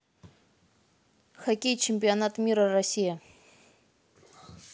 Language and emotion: Russian, neutral